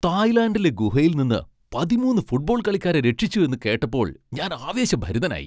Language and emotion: Malayalam, happy